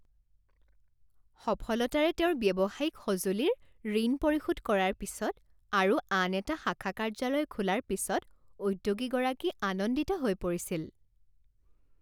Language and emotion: Assamese, happy